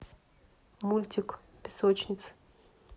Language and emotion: Russian, neutral